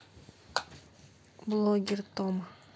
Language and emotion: Russian, neutral